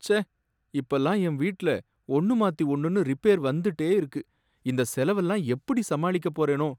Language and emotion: Tamil, sad